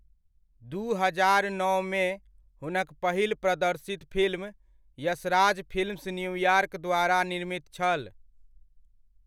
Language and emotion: Maithili, neutral